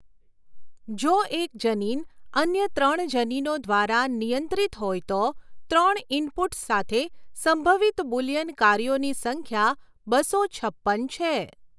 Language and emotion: Gujarati, neutral